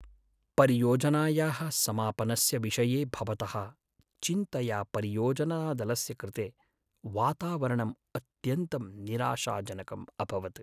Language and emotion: Sanskrit, sad